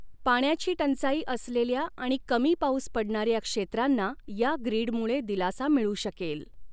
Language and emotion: Marathi, neutral